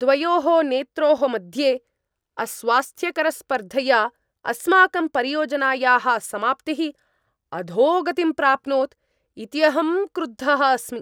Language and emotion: Sanskrit, angry